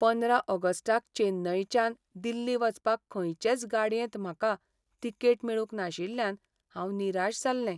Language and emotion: Goan Konkani, sad